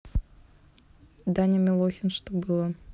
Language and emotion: Russian, neutral